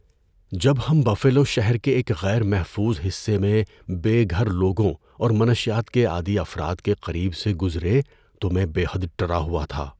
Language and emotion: Urdu, fearful